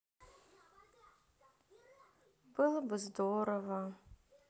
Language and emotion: Russian, sad